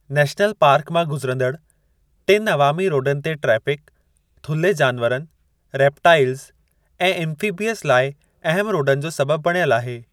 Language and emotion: Sindhi, neutral